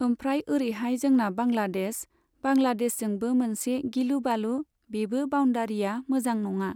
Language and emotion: Bodo, neutral